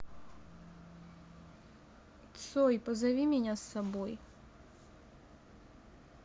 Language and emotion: Russian, sad